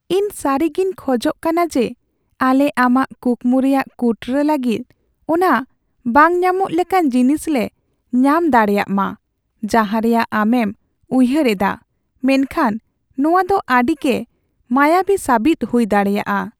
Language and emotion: Santali, sad